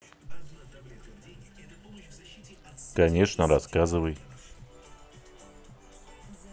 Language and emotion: Russian, neutral